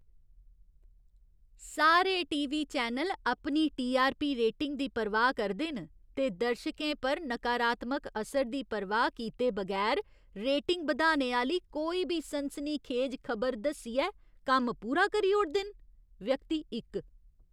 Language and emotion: Dogri, disgusted